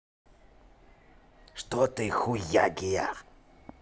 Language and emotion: Russian, angry